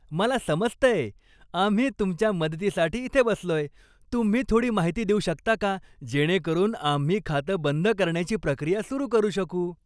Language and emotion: Marathi, happy